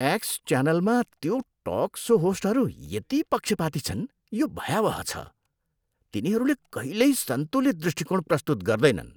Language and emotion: Nepali, disgusted